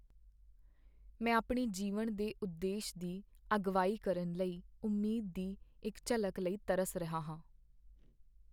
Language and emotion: Punjabi, sad